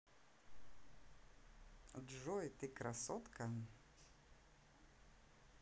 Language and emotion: Russian, positive